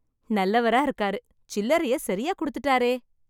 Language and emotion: Tamil, happy